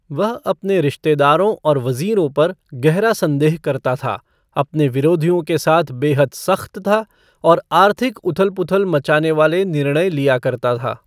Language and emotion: Hindi, neutral